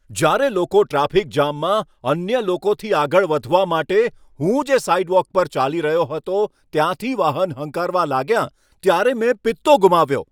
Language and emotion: Gujarati, angry